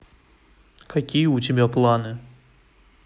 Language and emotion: Russian, neutral